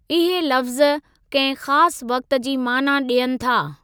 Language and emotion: Sindhi, neutral